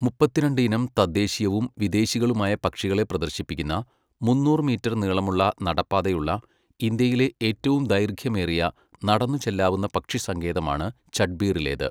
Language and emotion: Malayalam, neutral